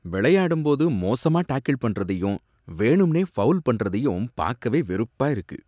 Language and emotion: Tamil, disgusted